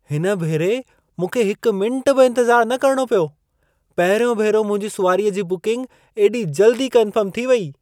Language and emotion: Sindhi, surprised